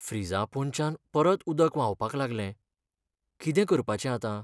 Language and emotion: Goan Konkani, sad